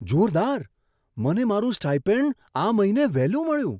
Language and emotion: Gujarati, surprised